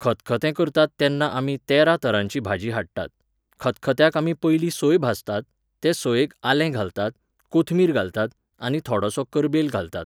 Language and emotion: Goan Konkani, neutral